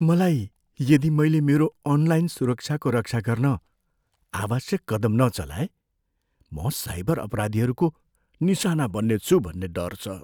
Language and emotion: Nepali, fearful